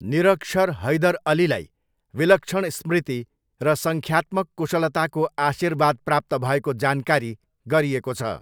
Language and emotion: Nepali, neutral